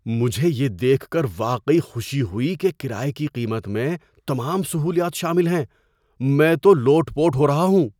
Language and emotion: Urdu, surprised